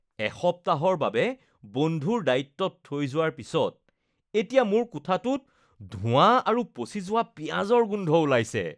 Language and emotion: Assamese, disgusted